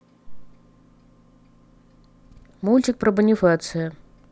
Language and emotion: Russian, neutral